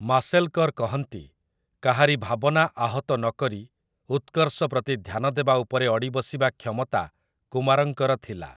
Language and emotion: Odia, neutral